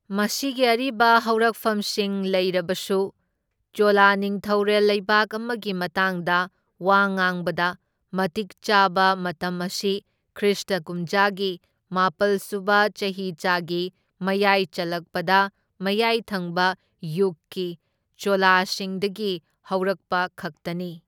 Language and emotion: Manipuri, neutral